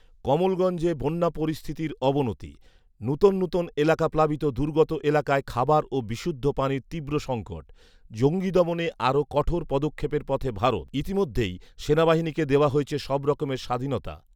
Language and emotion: Bengali, neutral